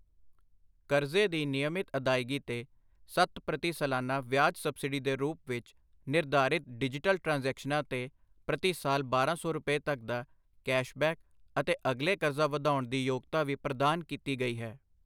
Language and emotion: Punjabi, neutral